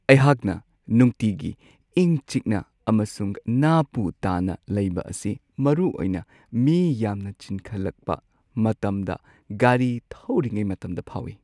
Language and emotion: Manipuri, sad